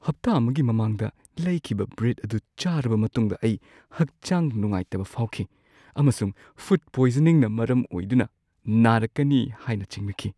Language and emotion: Manipuri, fearful